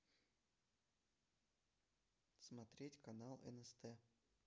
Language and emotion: Russian, neutral